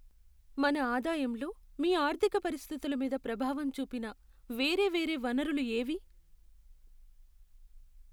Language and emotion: Telugu, sad